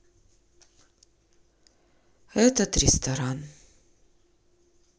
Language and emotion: Russian, sad